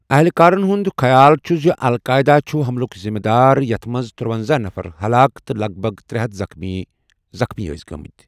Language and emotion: Kashmiri, neutral